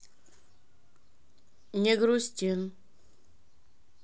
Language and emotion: Russian, neutral